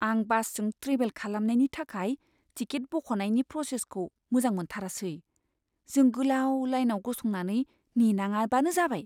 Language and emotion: Bodo, fearful